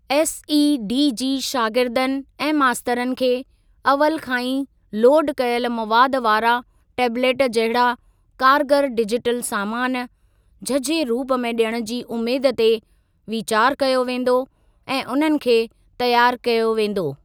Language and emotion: Sindhi, neutral